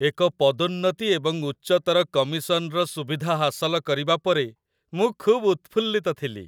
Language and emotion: Odia, happy